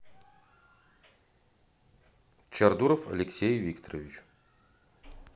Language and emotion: Russian, neutral